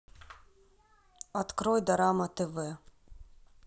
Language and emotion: Russian, neutral